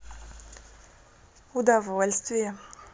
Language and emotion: Russian, positive